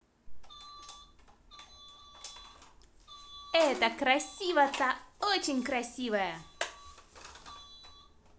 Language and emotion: Russian, positive